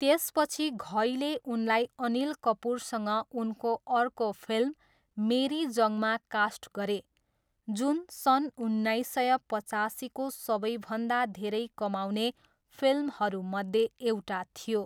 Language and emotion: Nepali, neutral